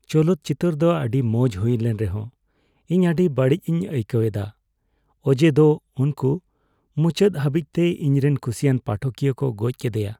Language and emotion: Santali, sad